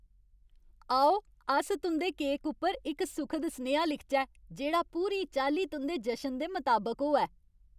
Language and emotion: Dogri, happy